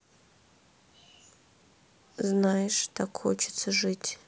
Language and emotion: Russian, sad